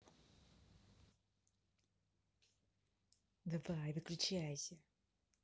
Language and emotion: Russian, angry